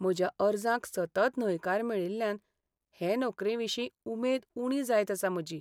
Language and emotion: Goan Konkani, sad